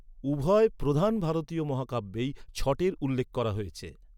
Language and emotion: Bengali, neutral